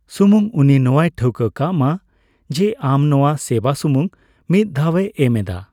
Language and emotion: Santali, neutral